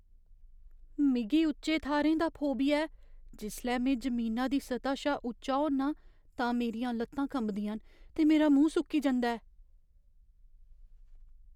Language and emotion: Dogri, fearful